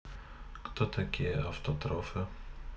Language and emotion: Russian, neutral